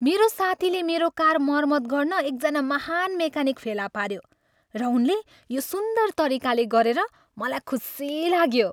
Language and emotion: Nepali, happy